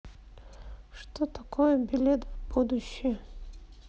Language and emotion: Russian, neutral